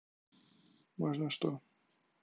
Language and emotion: Russian, neutral